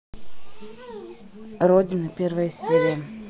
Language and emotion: Russian, neutral